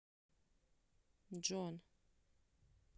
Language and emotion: Russian, neutral